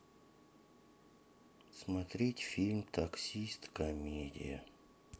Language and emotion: Russian, sad